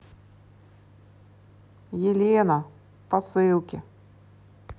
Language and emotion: Russian, neutral